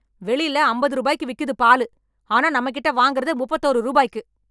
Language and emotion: Tamil, angry